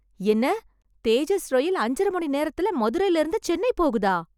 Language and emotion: Tamil, surprised